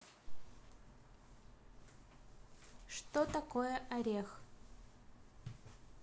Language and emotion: Russian, neutral